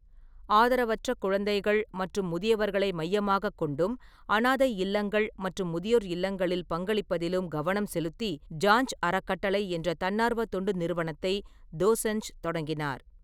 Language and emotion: Tamil, neutral